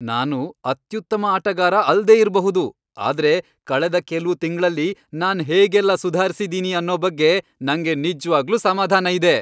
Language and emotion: Kannada, happy